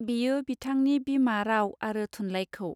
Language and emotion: Bodo, neutral